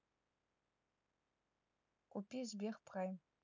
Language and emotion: Russian, neutral